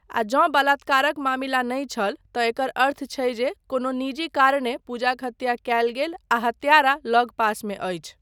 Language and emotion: Maithili, neutral